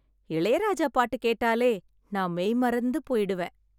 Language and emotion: Tamil, happy